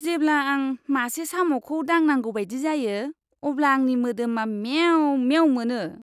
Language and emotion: Bodo, disgusted